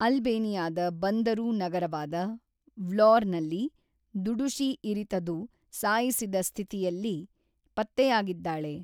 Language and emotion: Kannada, neutral